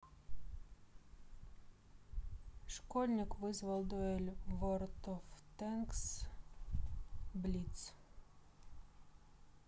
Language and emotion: Russian, neutral